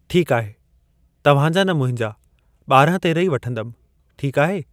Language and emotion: Sindhi, neutral